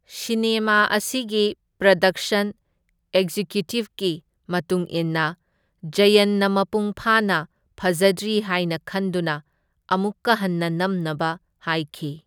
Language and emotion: Manipuri, neutral